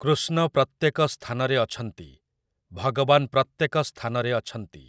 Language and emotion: Odia, neutral